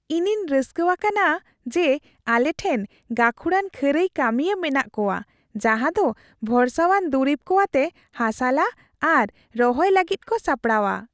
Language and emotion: Santali, happy